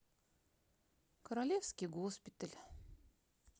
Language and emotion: Russian, neutral